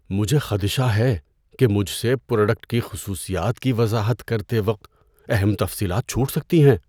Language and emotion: Urdu, fearful